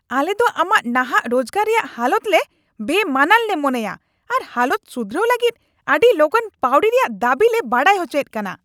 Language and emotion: Santali, angry